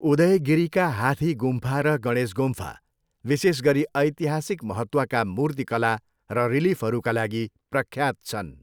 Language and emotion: Nepali, neutral